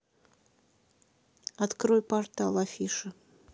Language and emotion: Russian, neutral